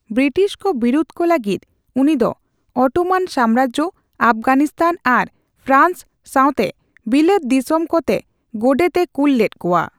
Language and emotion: Santali, neutral